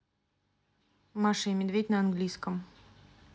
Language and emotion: Russian, neutral